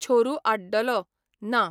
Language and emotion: Goan Konkani, neutral